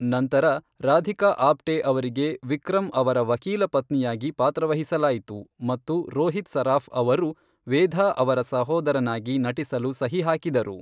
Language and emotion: Kannada, neutral